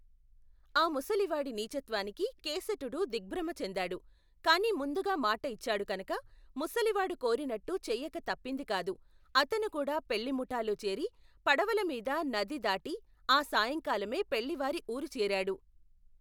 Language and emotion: Telugu, neutral